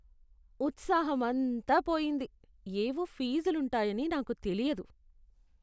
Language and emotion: Telugu, disgusted